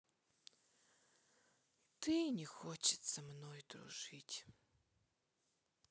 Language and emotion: Russian, sad